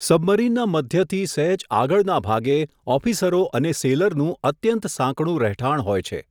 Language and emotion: Gujarati, neutral